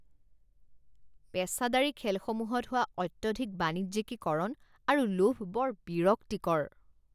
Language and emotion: Assamese, disgusted